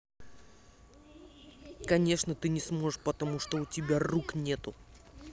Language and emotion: Russian, angry